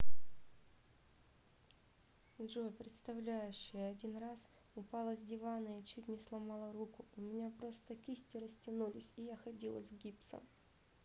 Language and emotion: Russian, sad